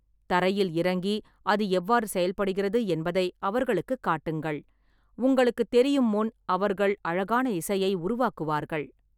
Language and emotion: Tamil, neutral